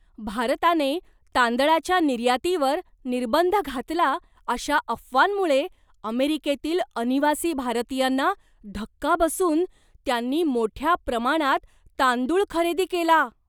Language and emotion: Marathi, surprised